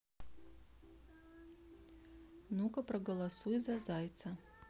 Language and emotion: Russian, neutral